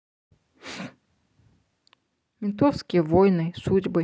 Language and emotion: Russian, neutral